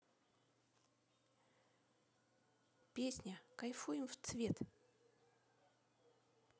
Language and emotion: Russian, neutral